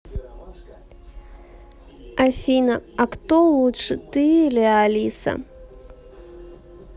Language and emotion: Russian, neutral